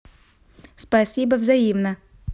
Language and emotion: Russian, neutral